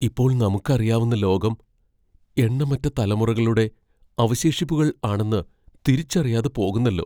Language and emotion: Malayalam, fearful